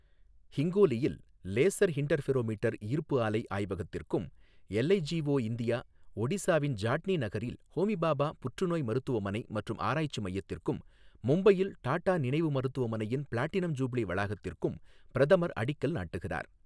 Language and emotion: Tamil, neutral